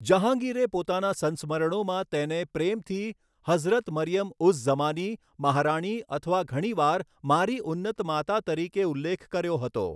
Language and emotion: Gujarati, neutral